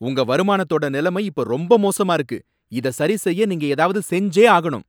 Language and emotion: Tamil, angry